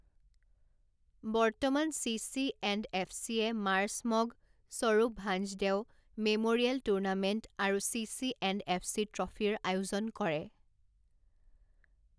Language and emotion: Assamese, neutral